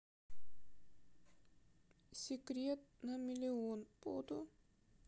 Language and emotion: Russian, sad